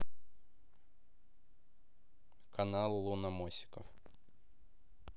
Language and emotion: Russian, neutral